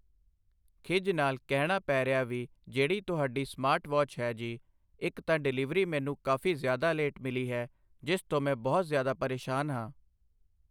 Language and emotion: Punjabi, neutral